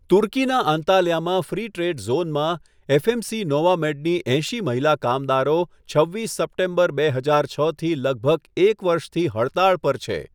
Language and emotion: Gujarati, neutral